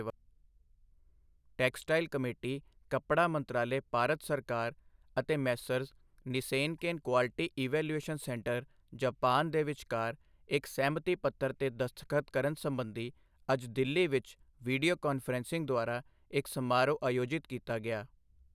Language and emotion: Punjabi, neutral